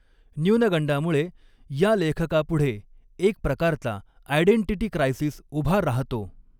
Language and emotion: Marathi, neutral